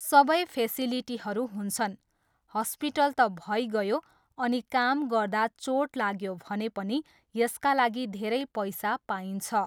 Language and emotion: Nepali, neutral